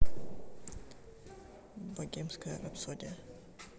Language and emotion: Russian, neutral